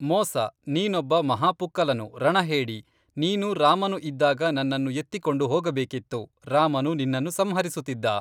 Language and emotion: Kannada, neutral